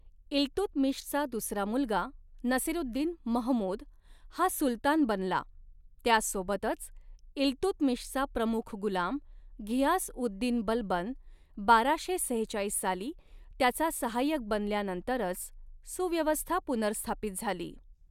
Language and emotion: Marathi, neutral